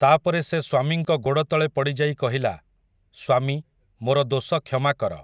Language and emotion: Odia, neutral